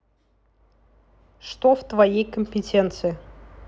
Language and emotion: Russian, neutral